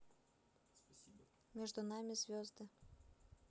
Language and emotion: Russian, neutral